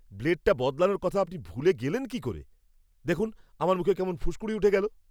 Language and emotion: Bengali, angry